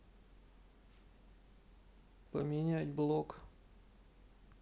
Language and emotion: Russian, sad